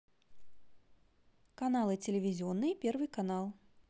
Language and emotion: Russian, positive